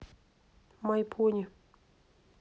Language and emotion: Russian, neutral